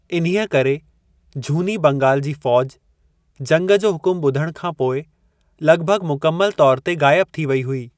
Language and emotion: Sindhi, neutral